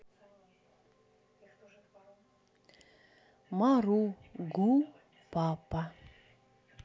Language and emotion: Russian, neutral